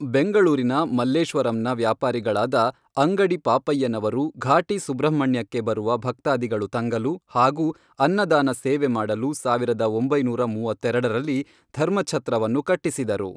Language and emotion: Kannada, neutral